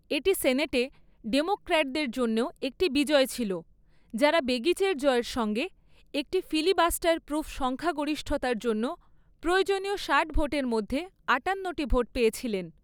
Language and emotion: Bengali, neutral